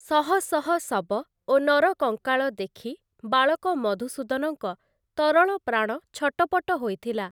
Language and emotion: Odia, neutral